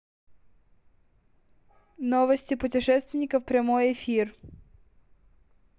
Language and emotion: Russian, neutral